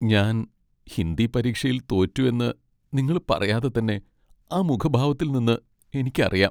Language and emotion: Malayalam, sad